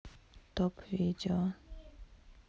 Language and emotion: Russian, neutral